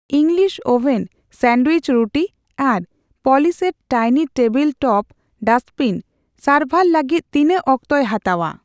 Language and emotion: Santali, neutral